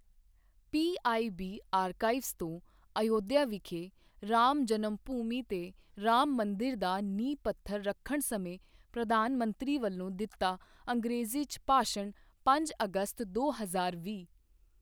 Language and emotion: Punjabi, neutral